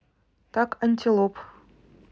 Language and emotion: Russian, neutral